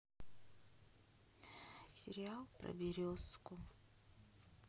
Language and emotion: Russian, sad